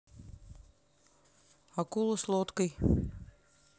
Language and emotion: Russian, neutral